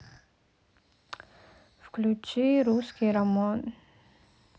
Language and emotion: Russian, sad